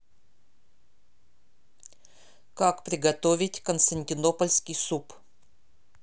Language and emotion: Russian, neutral